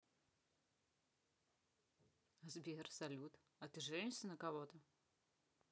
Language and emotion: Russian, neutral